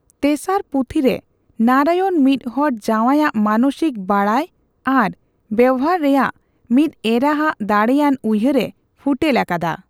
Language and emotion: Santali, neutral